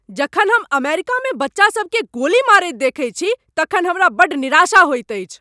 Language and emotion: Maithili, angry